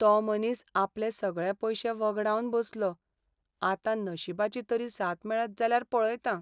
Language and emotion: Goan Konkani, sad